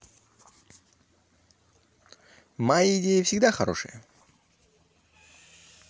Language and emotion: Russian, positive